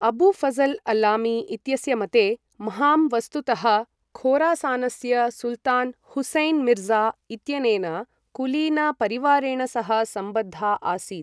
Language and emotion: Sanskrit, neutral